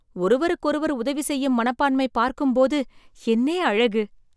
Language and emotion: Tamil, surprised